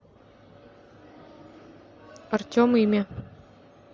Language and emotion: Russian, neutral